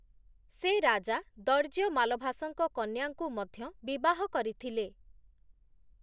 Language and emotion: Odia, neutral